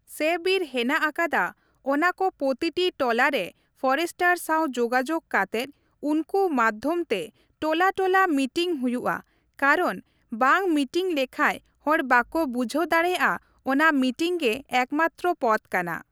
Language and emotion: Santali, neutral